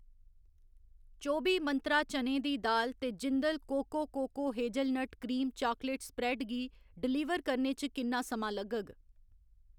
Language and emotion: Dogri, neutral